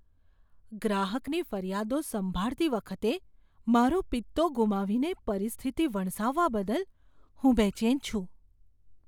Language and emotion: Gujarati, fearful